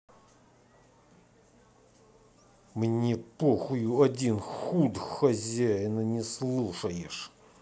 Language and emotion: Russian, angry